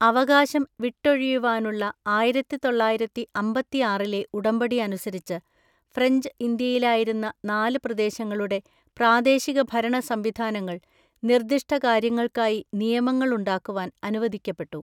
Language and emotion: Malayalam, neutral